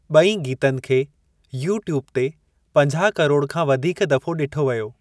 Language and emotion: Sindhi, neutral